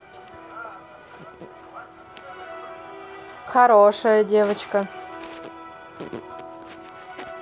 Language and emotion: Russian, positive